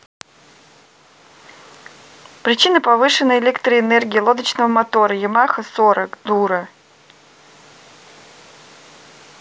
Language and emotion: Russian, neutral